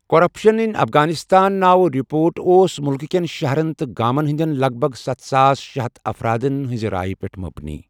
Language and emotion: Kashmiri, neutral